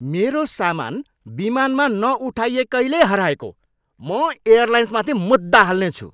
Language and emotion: Nepali, angry